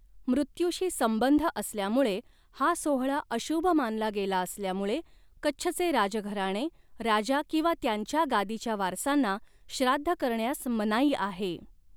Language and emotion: Marathi, neutral